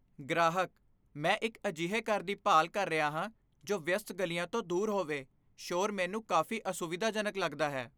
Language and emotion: Punjabi, fearful